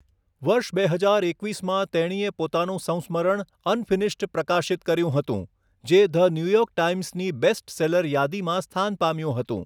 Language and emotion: Gujarati, neutral